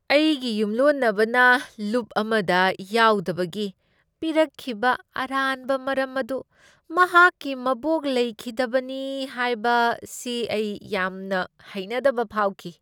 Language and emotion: Manipuri, disgusted